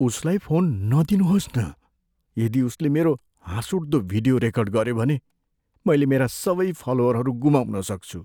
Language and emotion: Nepali, fearful